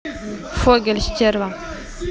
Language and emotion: Russian, neutral